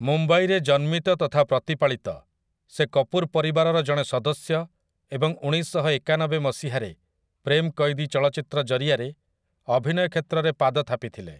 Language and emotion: Odia, neutral